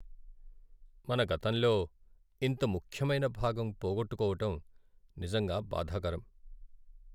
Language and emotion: Telugu, sad